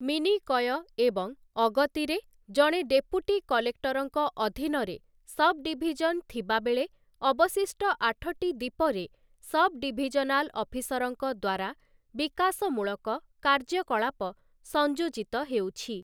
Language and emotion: Odia, neutral